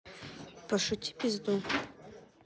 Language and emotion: Russian, neutral